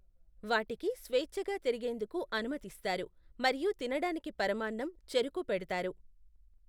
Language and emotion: Telugu, neutral